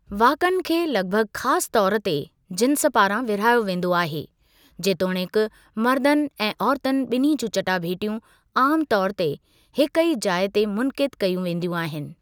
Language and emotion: Sindhi, neutral